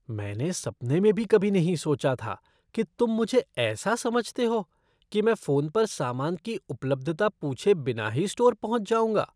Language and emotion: Hindi, disgusted